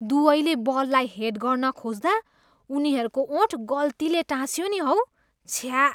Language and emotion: Nepali, disgusted